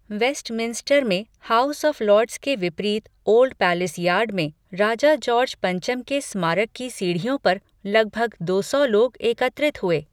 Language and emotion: Hindi, neutral